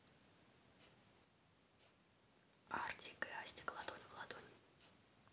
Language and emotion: Russian, neutral